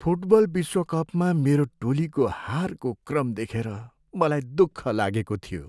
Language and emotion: Nepali, sad